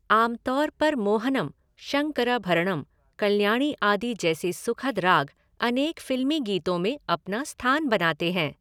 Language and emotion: Hindi, neutral